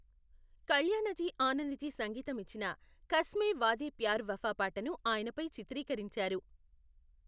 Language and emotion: Telugu, neutral